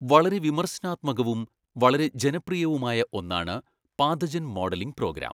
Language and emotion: Malayalam, neutral